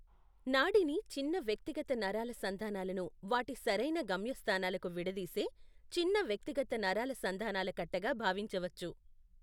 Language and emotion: Telugu, neutral